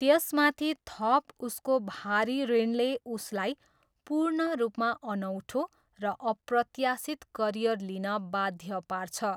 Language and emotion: Nepali, neutral